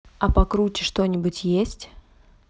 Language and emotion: Russian, neutral